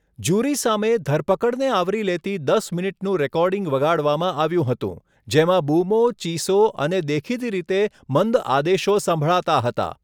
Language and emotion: Gujarati, neutral